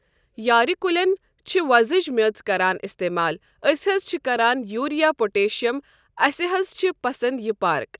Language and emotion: Kashmiri, neutral